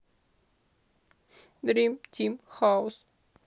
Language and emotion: Russian, sad